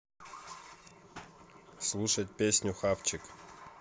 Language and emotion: Russian, neutral